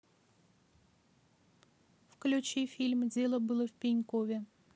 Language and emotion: Russian, neutral